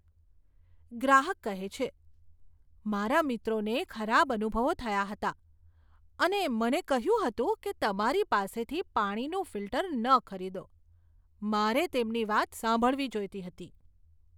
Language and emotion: Gujarati, disgusted